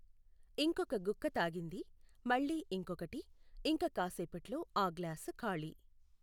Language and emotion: Telugu, neutral